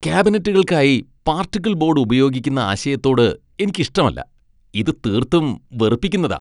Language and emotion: Malayalam, disgusted